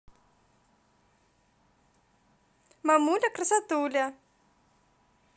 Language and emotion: Russian, positive